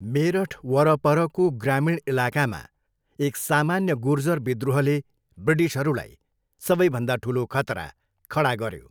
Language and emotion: Nepali, neutral